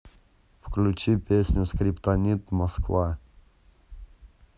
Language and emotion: Russian, neutral